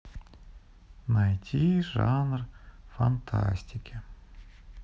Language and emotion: Russian, sad